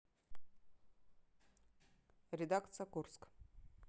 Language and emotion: Russian, neutral